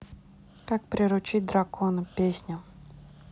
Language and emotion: Russian, neutral